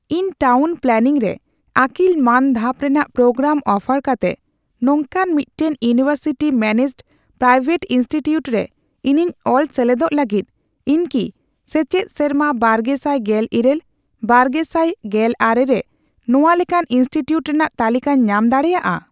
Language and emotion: Santali, neutral